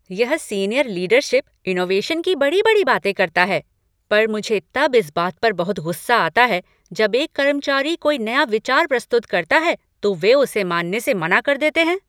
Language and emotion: Hindi, angry